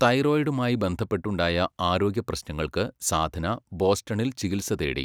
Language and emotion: Malayalam, neutral